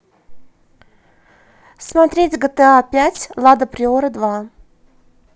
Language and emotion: Russian, positive